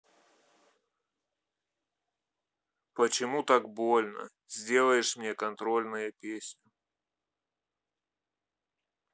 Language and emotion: Russian, sad